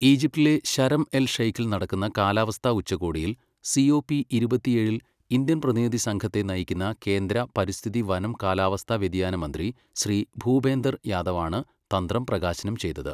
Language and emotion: Malayalam, neutral